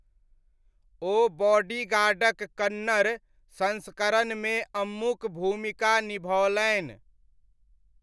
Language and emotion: Maithili, neutral